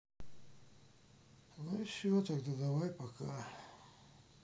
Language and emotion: Russian, sad